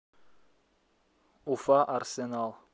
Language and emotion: Russian, neutral